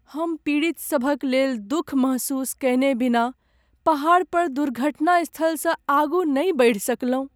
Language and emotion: Maithili, sad